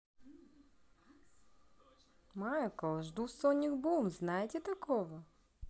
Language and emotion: Russian, positive